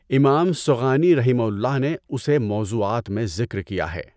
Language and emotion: Urdu, neutral